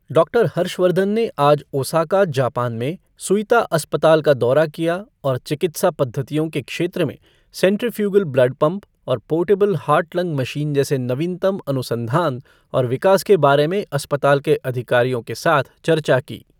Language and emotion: Hindi, neutral